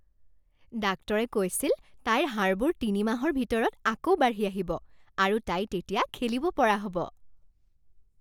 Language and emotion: Assamese, happy